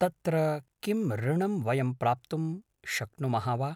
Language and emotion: Sanskrit, neutral